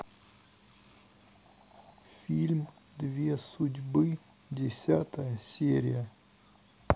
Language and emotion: Russian, sad